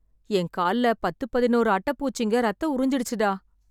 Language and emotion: Tamil, sad